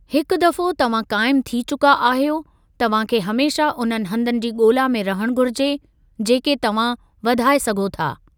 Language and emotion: Sindhi, neutral